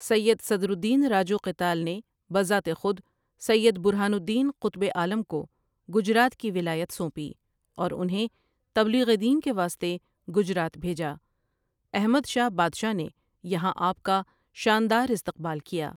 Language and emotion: Urdu, neutral